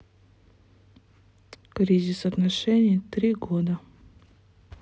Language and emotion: Russian, sad